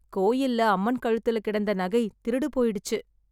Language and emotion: Tamil, sad